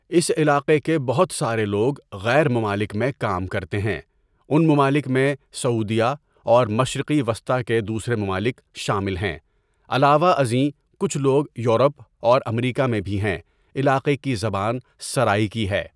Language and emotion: Urdu, neutral